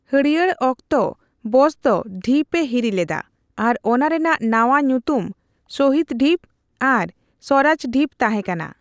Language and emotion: Santali, neutral